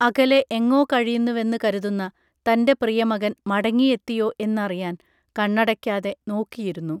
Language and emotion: Malayalam, neutral